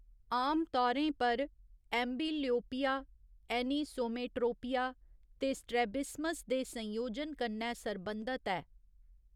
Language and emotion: Dogri, neutral